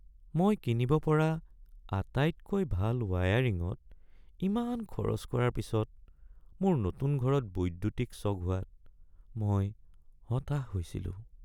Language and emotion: Assamese, sad